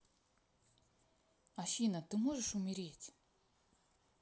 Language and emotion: Russian, neutral